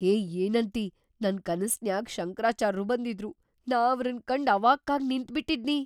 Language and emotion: Kannada, surprised